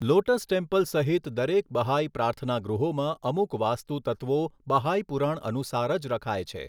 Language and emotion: Gujarati, neutral